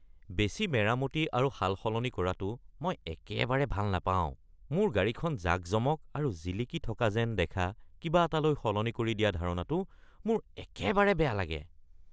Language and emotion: Assamese, disgusted